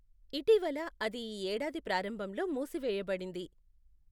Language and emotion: Telugu, neutral